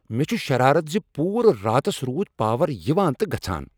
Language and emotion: Kashmiri, angry